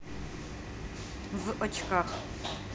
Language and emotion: Russian, neutral